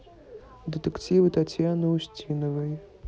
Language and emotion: Russian, neutral